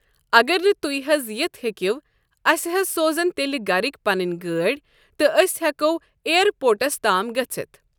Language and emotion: Kashmiri, neutral